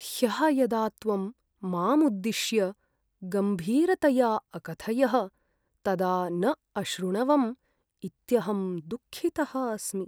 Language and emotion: Sanskrit, sad